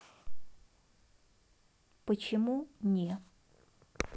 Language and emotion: Russian, neutral